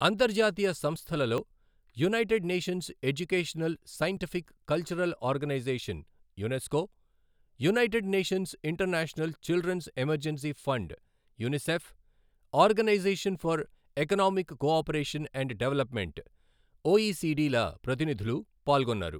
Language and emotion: Telugu, neutral